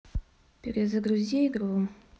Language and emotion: Russian, neutral